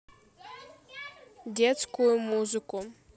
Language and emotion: Russian, neutral